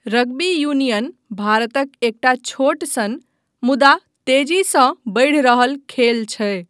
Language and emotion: Maithili, neutral